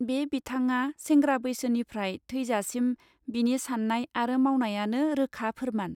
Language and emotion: Bodo, neutral